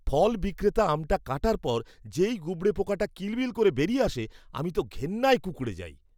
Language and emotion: Bengali, disgusted